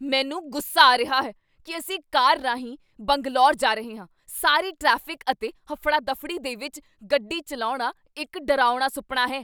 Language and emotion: Punjabi, angry